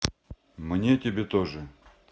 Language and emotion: Russian, neutral